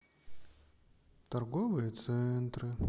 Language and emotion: Russian, sad